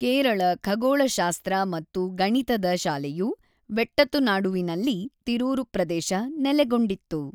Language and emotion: Kannada, neutral